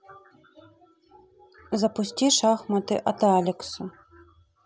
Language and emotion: Russian, neutral